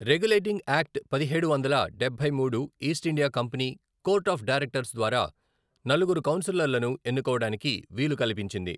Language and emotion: Telugu, neutral